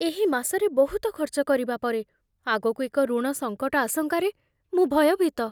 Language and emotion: Odia, fearful